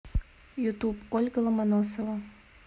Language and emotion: Russian, neutral